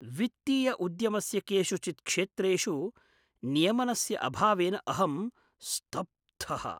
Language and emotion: Sanskrit, surprised